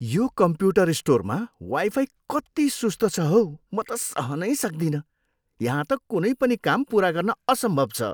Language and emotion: Nepali, disgusted